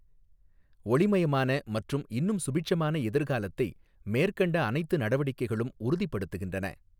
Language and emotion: Tamil, neutral